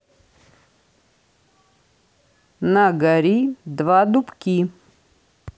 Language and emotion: Russian, neutral